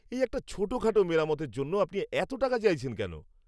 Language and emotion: Bengali, angry